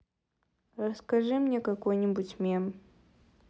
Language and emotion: Russian, neutral